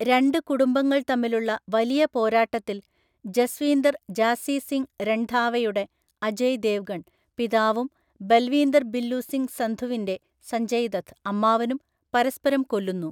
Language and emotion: Malayalam, neutral